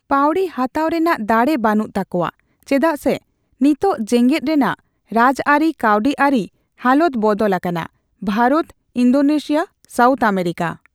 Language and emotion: Santali, neutral